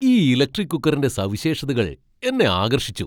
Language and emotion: Malayalam, surprised